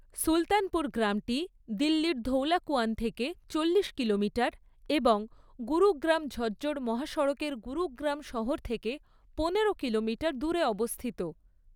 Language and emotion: Bengali, neutral